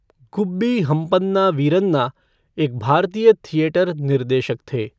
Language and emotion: Hindi, neutral